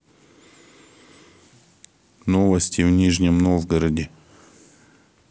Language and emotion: Russian, neutral